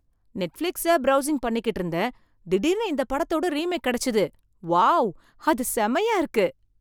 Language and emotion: Tamil, surprised